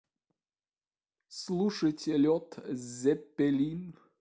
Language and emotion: Russian, neutral